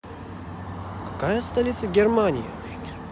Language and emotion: Russian, positive